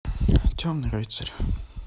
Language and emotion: Russian, sad